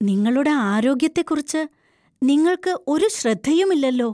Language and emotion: Malayalam, fearful